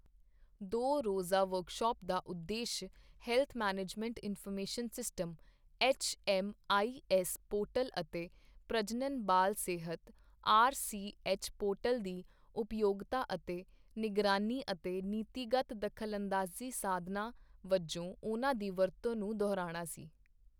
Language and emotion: Punjabi, neutral